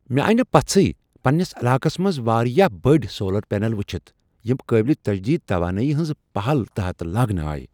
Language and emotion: Kashmiri, surprised